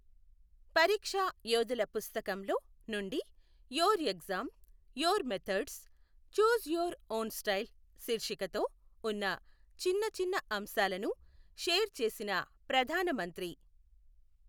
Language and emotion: Telugu, neutral